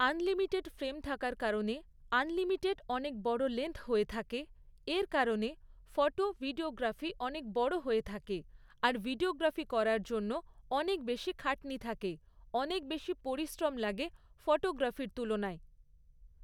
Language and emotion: Bengali, neutral